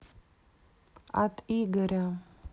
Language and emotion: Russian, neutral